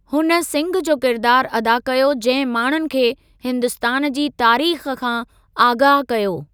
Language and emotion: Sindhi, neutral